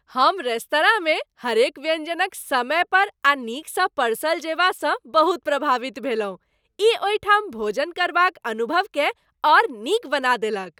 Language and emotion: Maithili, happy